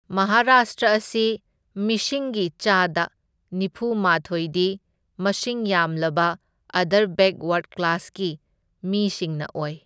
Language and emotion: Manipuri, neutral